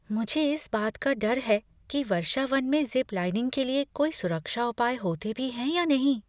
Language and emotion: Hindi, fearful